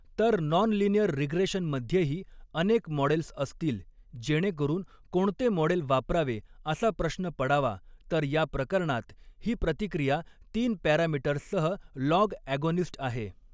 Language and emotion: Marathi, neutral